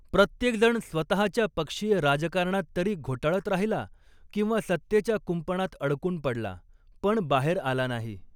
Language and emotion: Marathi, neutral